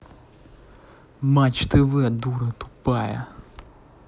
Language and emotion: Russian, angry